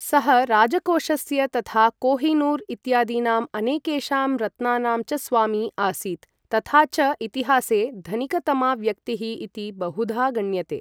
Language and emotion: Sanskrit, neutral